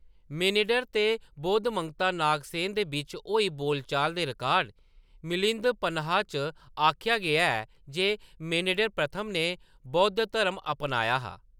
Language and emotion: Dogri, neutral